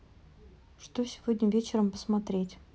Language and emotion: Russian, neutral